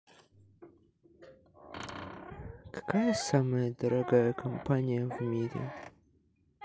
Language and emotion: Russian, neutral